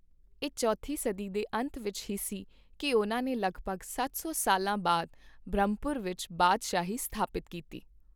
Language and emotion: Punjabi, neutral